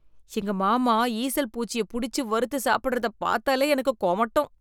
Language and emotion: Tamil, disgusted